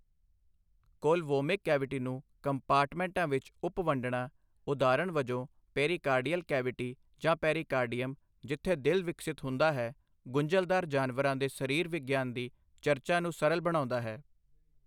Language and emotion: Punjabi, neutral